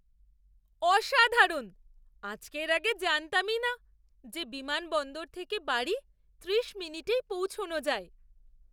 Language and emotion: Bengali, surprised